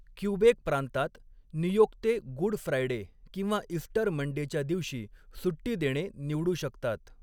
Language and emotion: Marathi, neutral